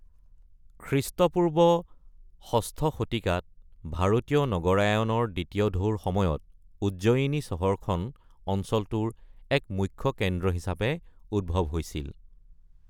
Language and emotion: Assamese, neutral